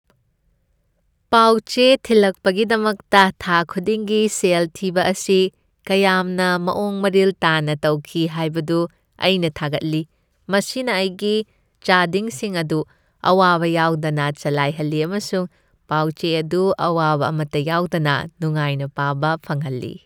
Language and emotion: Manipuri, happy